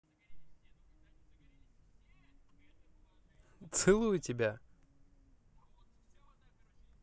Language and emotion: Russian, positive